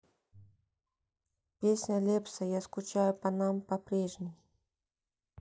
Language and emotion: Russian, neutral